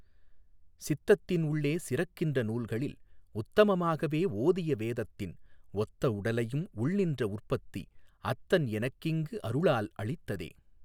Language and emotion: Tamil, neutral